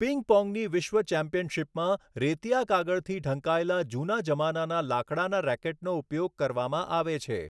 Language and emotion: Gujarati, neutral